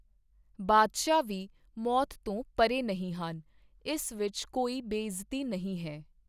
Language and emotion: Punjabi, neutral